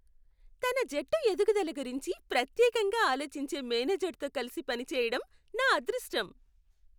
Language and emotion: Telugu, happy